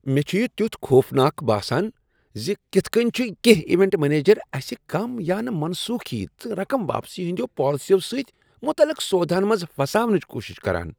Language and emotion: Kashmiri, disgusted